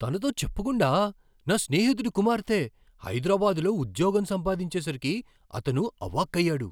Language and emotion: Telugu, surprised